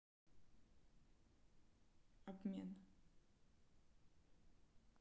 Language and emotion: Russian, neutral